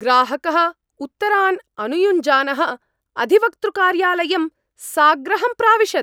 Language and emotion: Sanskrit, angry